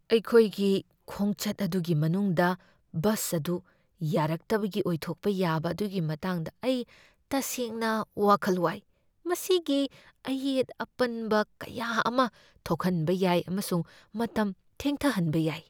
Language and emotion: Manipuri, fearful